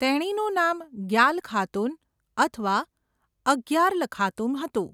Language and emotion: Gujarati, neutral